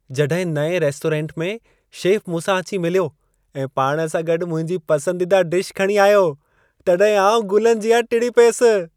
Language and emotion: Sindhi, happy